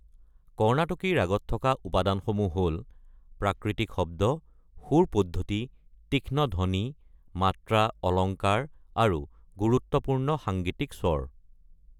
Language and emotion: Assamese, neutral